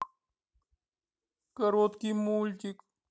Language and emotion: Russian, sad